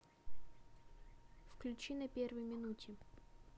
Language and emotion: Russian, neutral